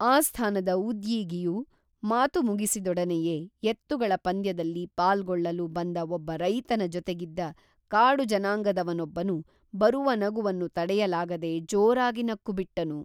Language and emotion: Kannada, neutral